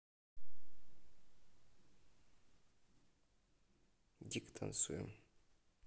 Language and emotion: Russian, neutral